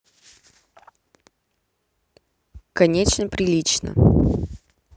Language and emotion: Russian, neutral